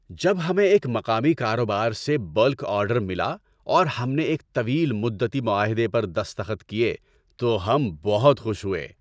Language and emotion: Urdu, happy